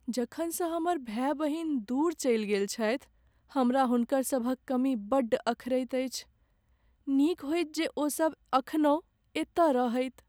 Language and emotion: Maithili, sad